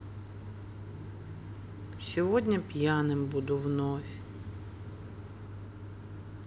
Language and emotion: Russian, sad